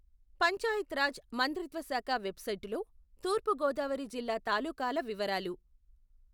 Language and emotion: Telugu, neutral